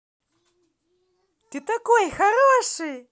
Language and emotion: Russian, positive